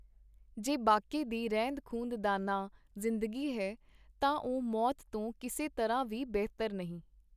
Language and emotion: Punjabi, neutral